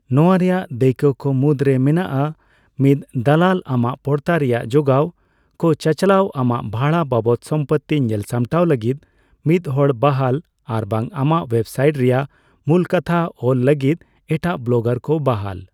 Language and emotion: Santali, neutral